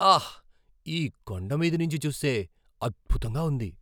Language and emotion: Telugu, surprised